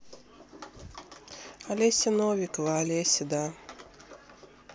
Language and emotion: Russian, neutral